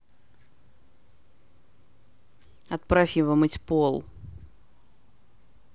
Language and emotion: Russian, angry